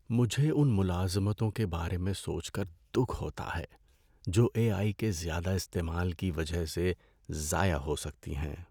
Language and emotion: Urdu, sad